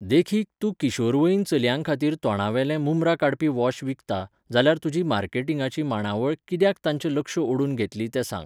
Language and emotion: Goan Konkani, neutral